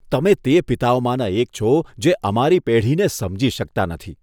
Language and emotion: Gujarati, disgusted